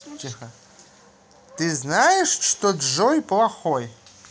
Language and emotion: Russian, positive